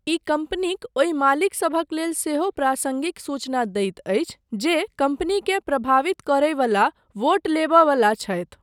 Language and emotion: Maithili, neutral